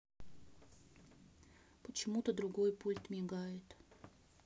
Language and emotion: Russian, neutral